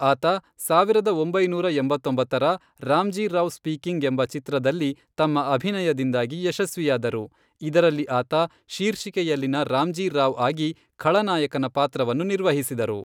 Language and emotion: Kannada, neutral